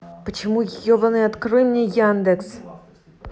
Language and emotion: Russian, angry